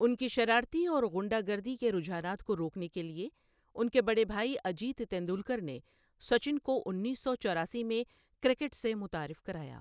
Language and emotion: Urdu, neutral